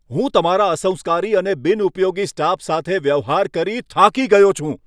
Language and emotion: Gujarati, angry